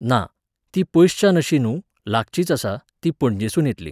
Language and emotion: Goan Konkani, neutral